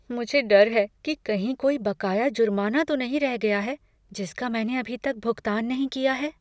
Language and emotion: Hindi, fearful